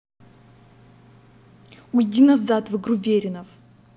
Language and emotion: Russian, angry